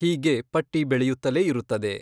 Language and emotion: Kannada, neutral